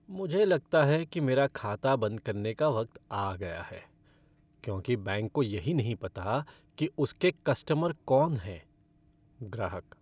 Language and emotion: Hindi, sad